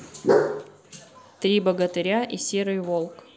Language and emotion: Russian, neutral